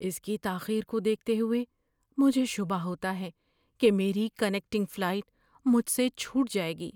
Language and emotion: Urdu, fearful